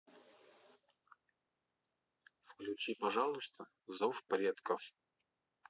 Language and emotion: Russian, neutral